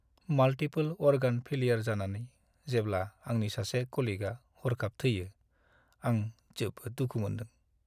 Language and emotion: Bodo, sad